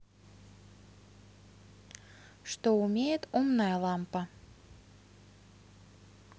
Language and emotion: Russian, neutral